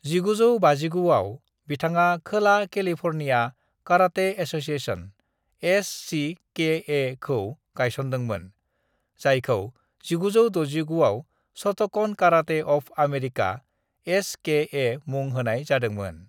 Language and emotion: Bodo, neutral